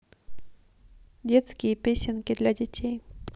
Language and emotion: Russian, neutral